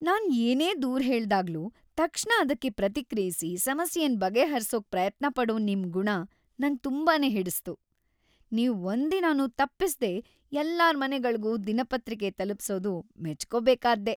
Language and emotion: Kannada, happy